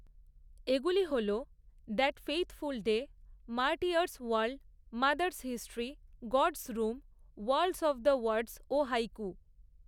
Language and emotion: Bengali, neutral